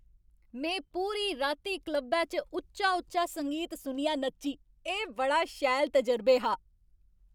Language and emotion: Dogri, happy